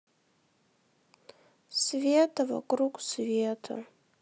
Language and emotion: Russian, sad